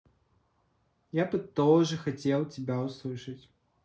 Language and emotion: Russian, neutral